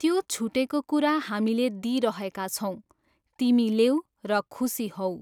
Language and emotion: Nepali, neutral